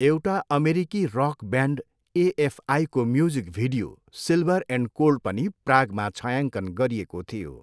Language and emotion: Nepali, neutral